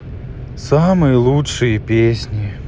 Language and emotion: Russian, sad